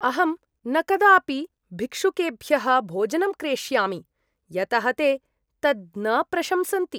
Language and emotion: Sanskrit, disgusted